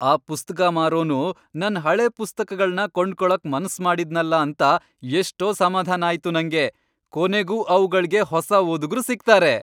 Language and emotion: Kannada, happy